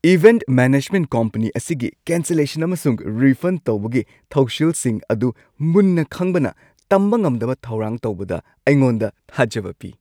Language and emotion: Manipuri, happy